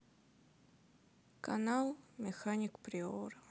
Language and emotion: Russian, sad